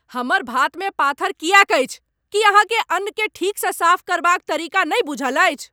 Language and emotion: Maithili, angry